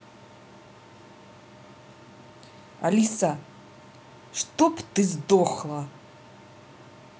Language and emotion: Russian, angry